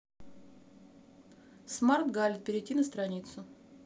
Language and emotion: Russian, neutral